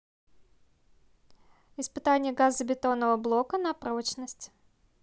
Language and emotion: Russian, neutral